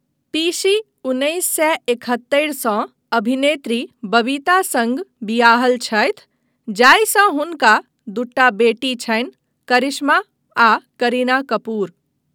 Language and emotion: Maithili, neutral